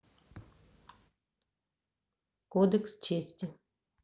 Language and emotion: Russian, neutral